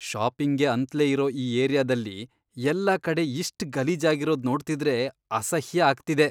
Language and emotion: Kannada, disgusted